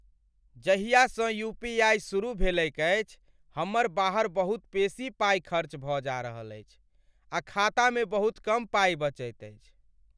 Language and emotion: Maithili, sad